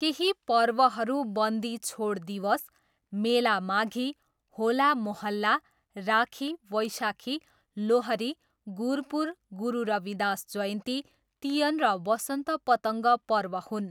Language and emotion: Nepali, neutral